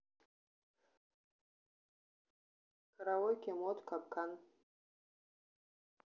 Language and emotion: Russian, neutral